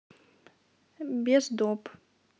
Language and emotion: Russian, neutral